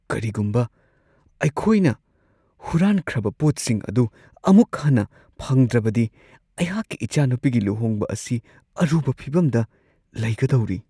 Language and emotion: Manipuri, fearful